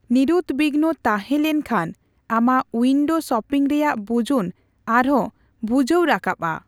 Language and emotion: Santali, neutral